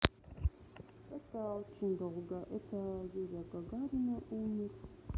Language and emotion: Russian, neutral